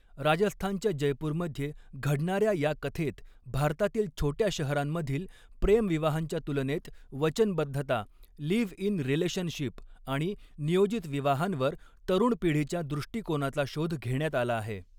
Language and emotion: Marathi, neutral